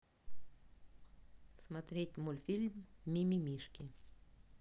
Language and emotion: Russian, neutral